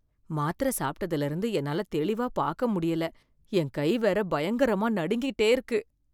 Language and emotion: Tamil, fearful